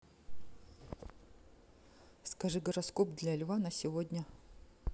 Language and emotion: Russian, neutral